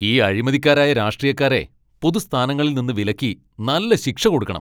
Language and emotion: Malayalam, angry